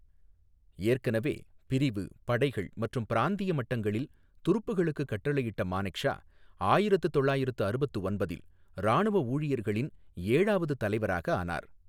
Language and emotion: Tamil, neutral